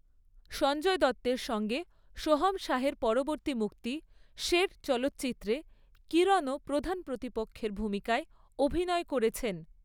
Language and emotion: Bengali, neutral